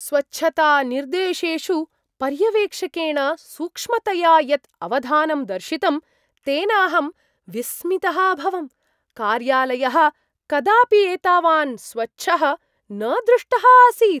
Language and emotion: Sanskrit, surprised